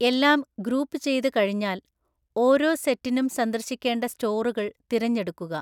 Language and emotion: Malayalam, neutral